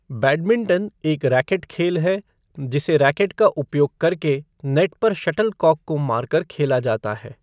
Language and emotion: Hindi, neutral